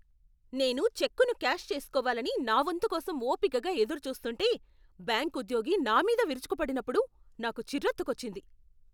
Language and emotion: Telugu, angry